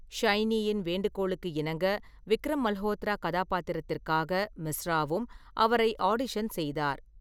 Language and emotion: Tamil, neutral